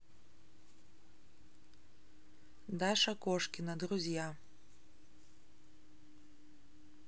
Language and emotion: Russian, neutral